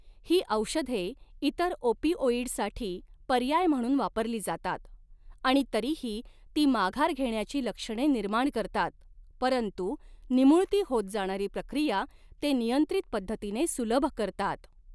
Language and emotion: Marathi, neutral